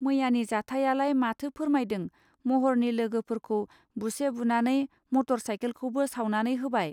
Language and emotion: Bodo, neutral